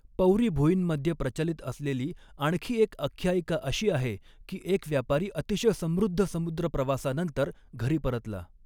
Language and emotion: Marathi, neutral